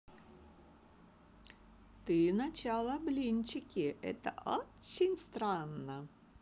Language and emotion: Russian, positive